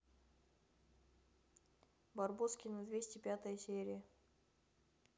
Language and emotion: Russian, neutral